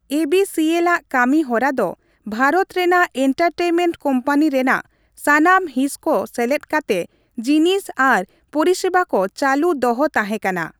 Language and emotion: Santali, neutral